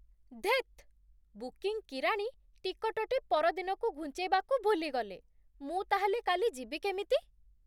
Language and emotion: Odia, surprised